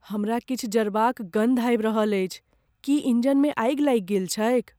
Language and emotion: Maithili, fearful